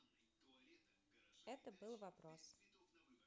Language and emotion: Russian, neutral